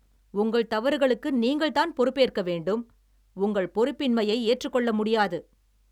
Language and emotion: Tamil, angry